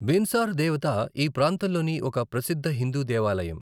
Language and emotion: Telugu, neutral